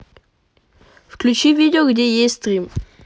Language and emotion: Russian, neutral